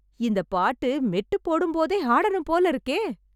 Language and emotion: Tamil, happy